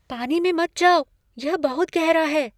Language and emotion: Hindi, fearful